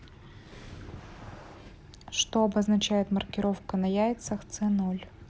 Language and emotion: Russian, neutral